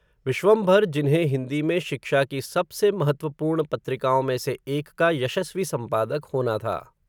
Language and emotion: Hindi, neutral